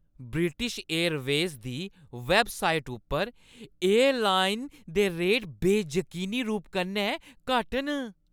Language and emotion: Dogri, happy